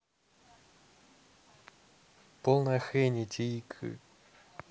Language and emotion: Russian, neutral